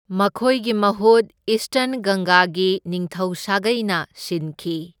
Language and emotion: Manipuri, neutral